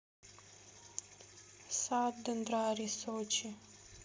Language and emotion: Russian, neutral